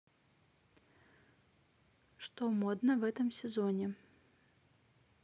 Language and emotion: Russian, neutral